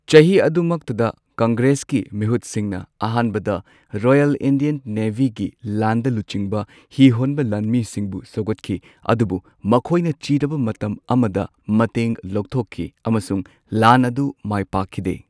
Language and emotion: Manipuri, neutral